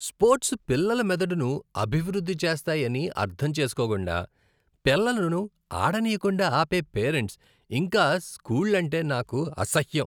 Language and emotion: Telugu, disgusted